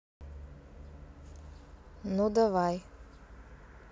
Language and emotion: Russian, neutral